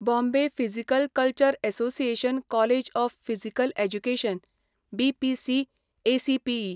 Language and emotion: Goan Konkani, neutral